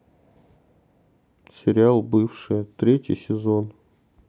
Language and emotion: Russian, sad